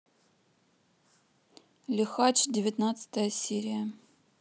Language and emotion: Russian, neutral